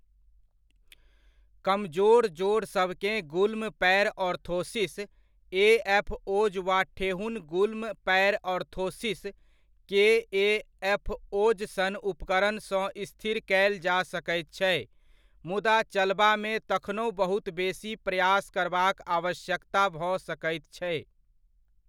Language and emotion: Maithili, neutral